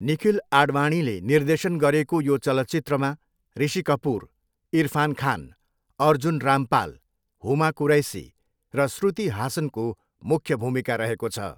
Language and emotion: Nepali, neutral